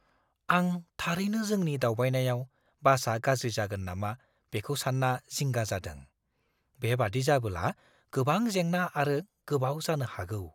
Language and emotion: Bodo, fearful